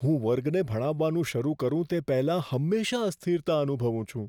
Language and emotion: Gujarati, fearful